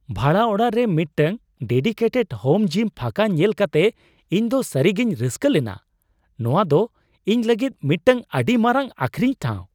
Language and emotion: Santali, surprised